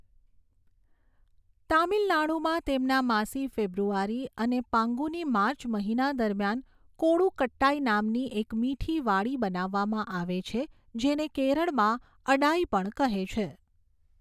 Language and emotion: Gujarati, neutral